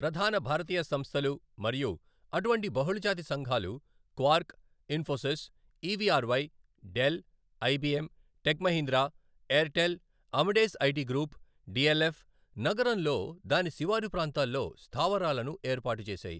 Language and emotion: Telugu, neutral